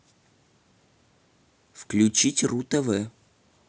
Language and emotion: Russian, neutral